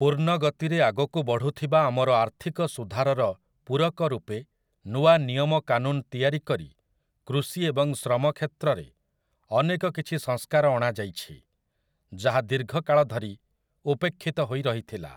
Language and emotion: Odia, neutral